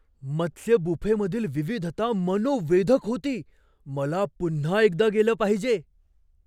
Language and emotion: Marathi, surprised